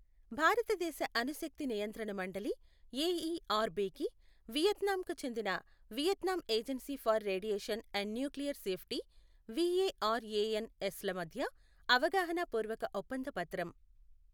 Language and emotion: Telugu, neutral